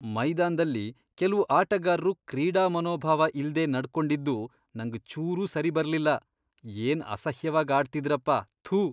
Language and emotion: Kannada, disgusted